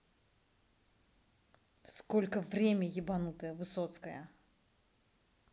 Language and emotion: Russian, angry